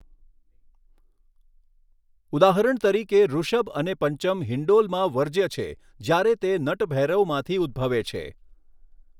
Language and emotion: Gujarati, neutral